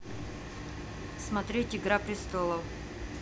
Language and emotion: Russian, neutral